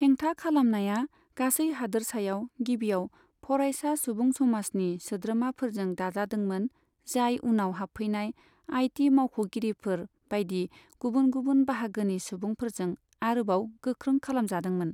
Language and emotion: Bodo, neutral